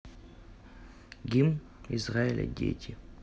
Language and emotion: Russian, neutral